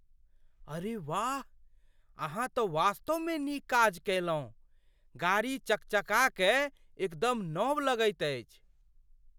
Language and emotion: Maithili, surprised